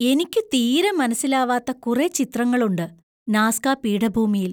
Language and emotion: Malayalam, surprised